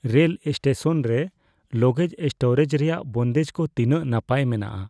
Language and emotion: Santali, fearful